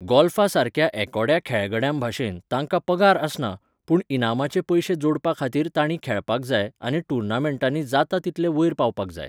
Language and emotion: Goan Konkani, neutral